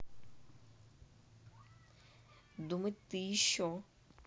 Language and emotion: Russian, neutral